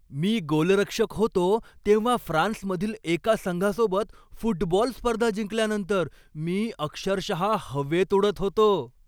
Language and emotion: Marathi, happy